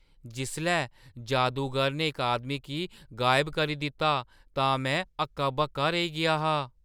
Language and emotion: Dogri, surprised